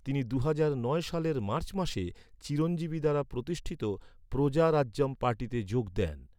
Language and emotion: Bengali, neutral